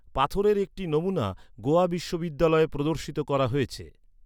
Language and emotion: Bengali, neutral